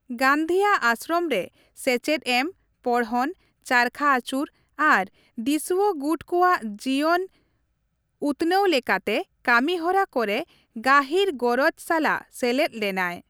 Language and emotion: Santali, neutral